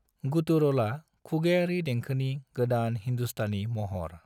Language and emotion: Bodo, neutral